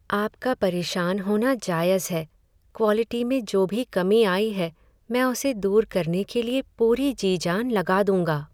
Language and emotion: Hindi, sad